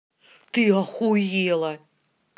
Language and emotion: Russian, angry